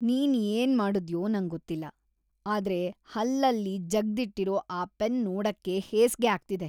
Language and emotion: Kannada, disgusted